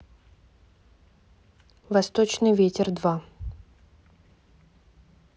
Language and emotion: Russian, neutral